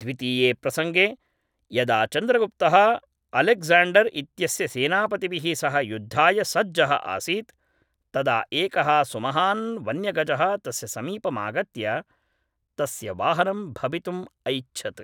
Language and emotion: Sanskrit, neutral